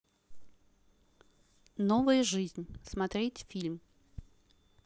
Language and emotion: Russian, neutral